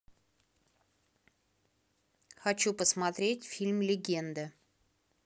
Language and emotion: Russian, neutral